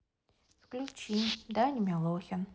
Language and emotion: Russian, neutral